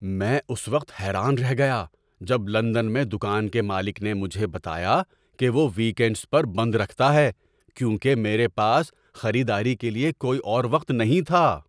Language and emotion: Urdu, surprised